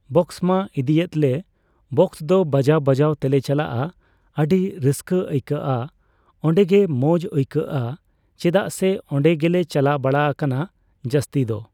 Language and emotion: Santali, neutral